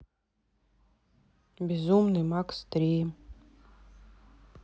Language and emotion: Russian, neutral